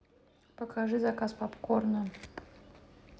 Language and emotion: Russian, neutral